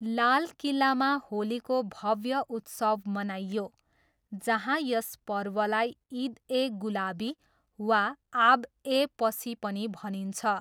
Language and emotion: Nepali, neutral